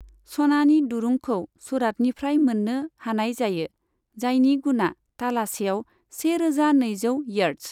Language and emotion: Bodo, neutral